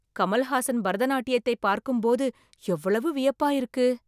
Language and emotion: Tamil, surprised